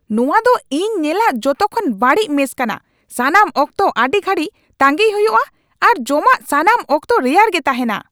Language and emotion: Santali, angry